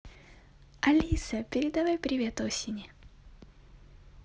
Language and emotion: Russian, positive